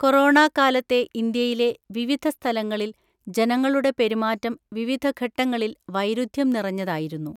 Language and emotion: Malayalam, neutral